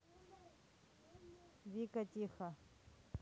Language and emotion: Russian, neutral